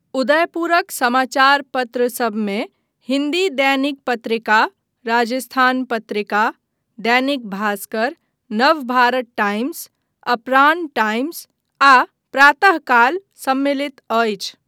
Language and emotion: Maithili, neutral